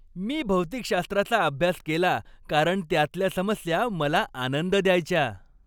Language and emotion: Marathi, happy